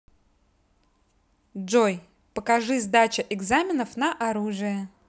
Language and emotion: Russian, positive